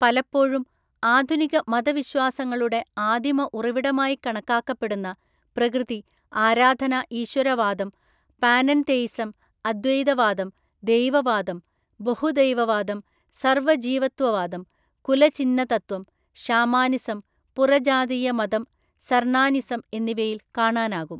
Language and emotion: Malayalam, neutral